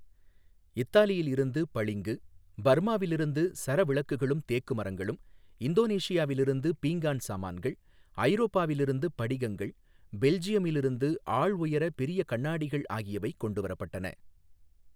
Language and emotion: Tamil, neutral